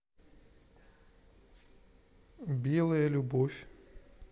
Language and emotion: Russian, neutral